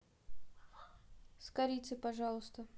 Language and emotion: Russian, neutral